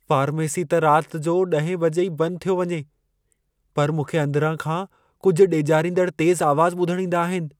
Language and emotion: Sindhi, fearful